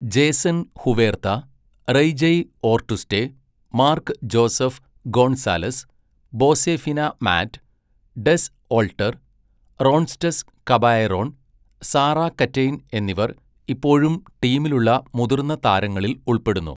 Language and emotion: Malayalam, neutral